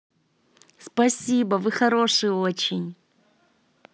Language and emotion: Russian, positive